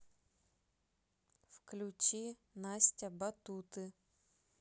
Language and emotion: Russian, neutral